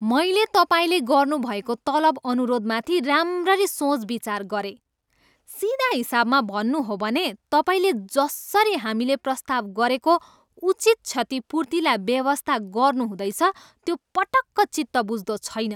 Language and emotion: Nepali, angry